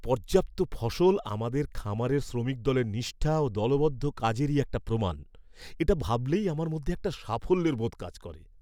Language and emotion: Bengali, happy